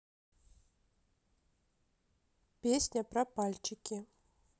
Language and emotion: Russian, neutral